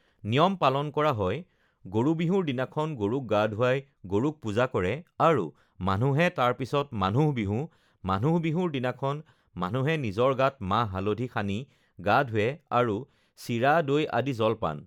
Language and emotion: Assamese, neutral